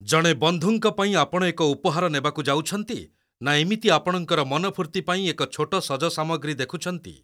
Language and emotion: Odia, neutral